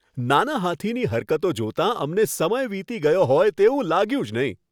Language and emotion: Gujarati, happy